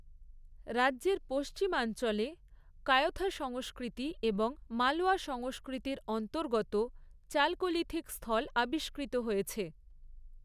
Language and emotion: Bengali, neutral